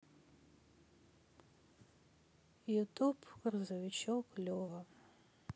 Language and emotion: Russian, sad